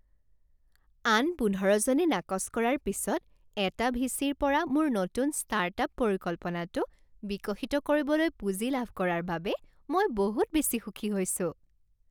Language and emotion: Assamese, happy